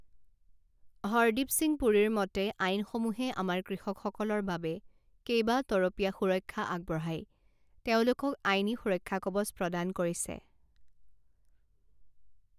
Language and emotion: Assamese, neutral